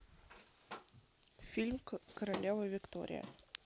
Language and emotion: Russian, neutral